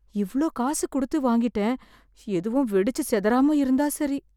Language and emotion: Tamil, fearful